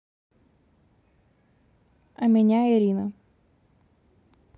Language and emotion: Russian, neutral